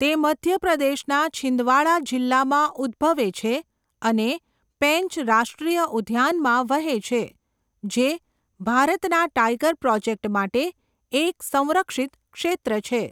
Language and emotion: Gujarati, neutral